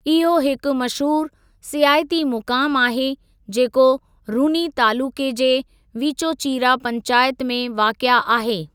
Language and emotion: Sindhi, neutral